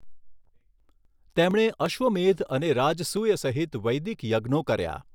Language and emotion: Gujarati, neutral